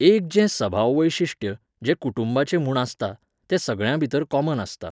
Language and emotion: Goan Konkani, neutral